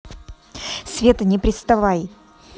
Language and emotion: Russian, angry